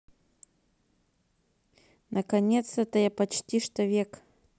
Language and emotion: Russian, neutral